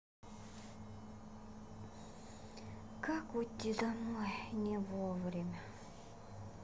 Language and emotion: Russian, sad